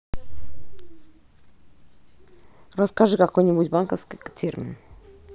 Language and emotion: Russian, neutral